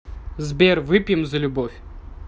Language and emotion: Russian, neutral